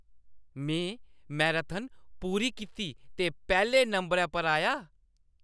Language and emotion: Dogri, happy